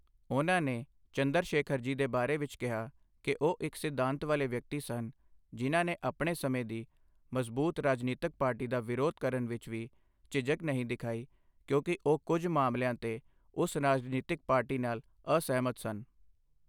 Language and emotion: Punjabi, neutral